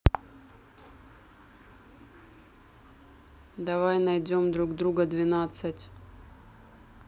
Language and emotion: Russian, neutral